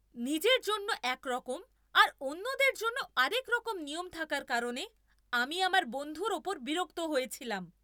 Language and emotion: Bengali, angry